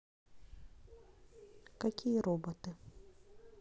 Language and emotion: Russian, neutral